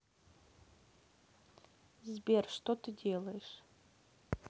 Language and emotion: Russian, neutral